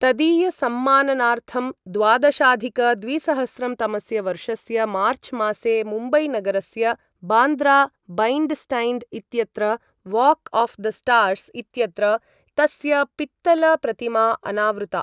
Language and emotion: Sanskrit, neutral